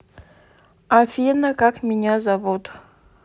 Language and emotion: Russian, neutral